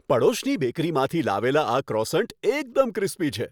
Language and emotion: Gujarati, happy